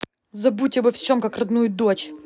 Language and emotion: Russian, angry